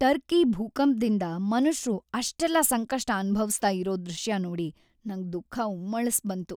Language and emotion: Kannada, sad